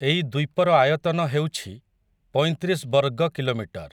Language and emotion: Odia, neutral